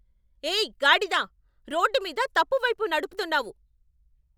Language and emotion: Telugu, angry